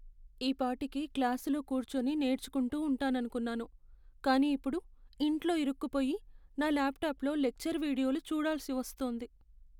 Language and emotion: Telugu, sad